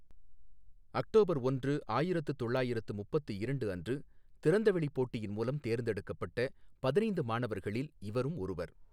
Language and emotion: Tamil, neutral